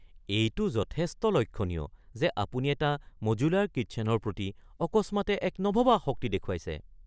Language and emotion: Assamese, surprised